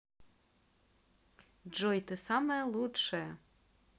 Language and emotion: Russian, positive